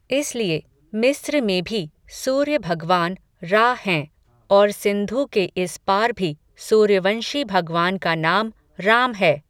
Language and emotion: Hindi, neutral